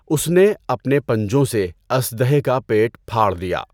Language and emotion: Urdu, neutral